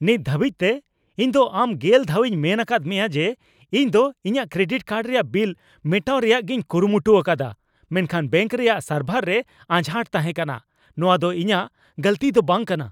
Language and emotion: Santali, angry